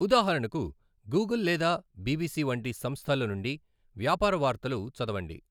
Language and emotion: Telugu, neutral